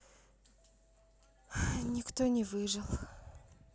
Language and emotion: Russian, sad